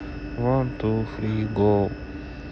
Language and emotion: Russian, sad